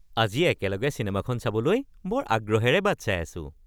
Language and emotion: Assamese, happy